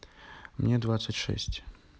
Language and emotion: Russian, neutral